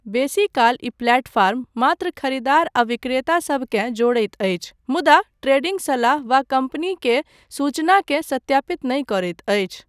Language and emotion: Maithili, neutral